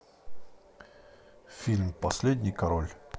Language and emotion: Russian, neutral